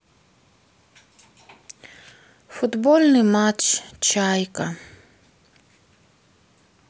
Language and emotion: Russian, sad